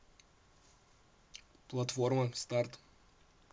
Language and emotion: Russian, neutral